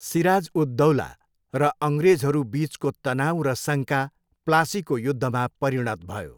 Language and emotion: Nepali, neutral